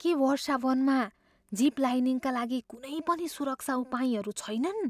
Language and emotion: Nepali, fearful